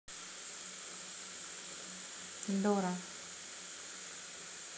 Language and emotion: Russian, neutral